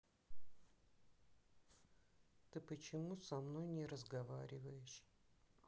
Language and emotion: Russian, sad